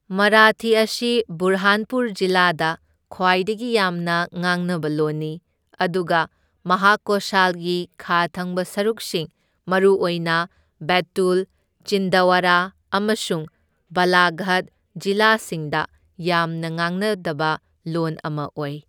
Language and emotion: Manipuri, neutral